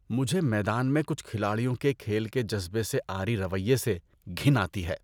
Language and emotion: Urdu, disgusted